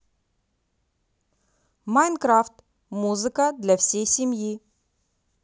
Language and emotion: Russian, positive